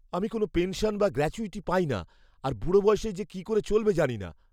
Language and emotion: Bengali, fearful